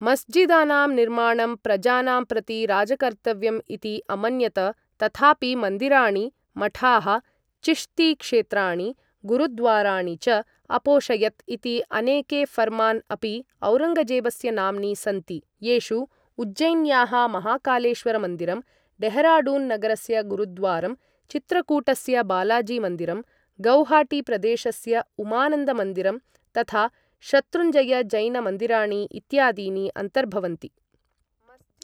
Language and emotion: Sanskrit, neutral